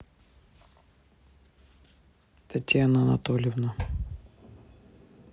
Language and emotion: Russian, neutral